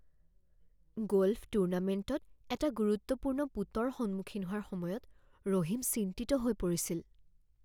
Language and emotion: Assamese, fearful